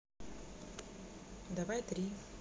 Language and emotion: Russian, neutral